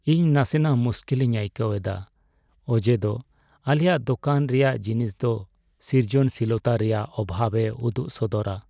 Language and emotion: Santali, sad